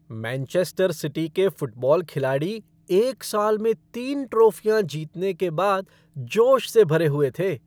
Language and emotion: Hindi, happy